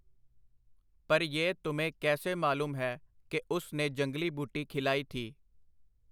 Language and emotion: Punjabi, neutral